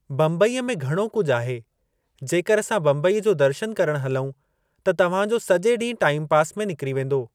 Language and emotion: Sindhi, neutral